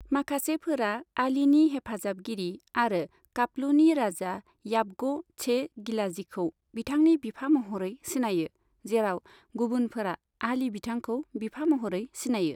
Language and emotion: Bodo, neutral